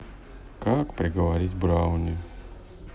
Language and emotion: Russian, sad